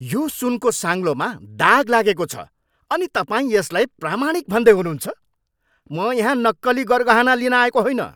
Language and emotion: Nepali, angry